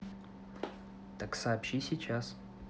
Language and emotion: Russian, neutral